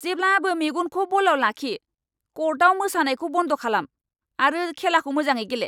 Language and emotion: Bodo, angry